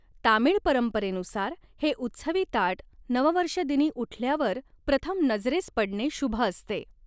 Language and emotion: Marathi, neutral